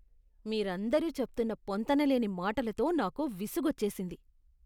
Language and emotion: Telugu, disgusted